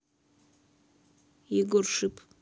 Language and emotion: Russian, neutral